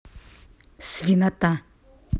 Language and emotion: Russian, angry